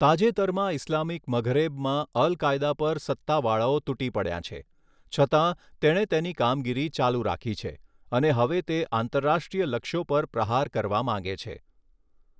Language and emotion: Gujarati, neutral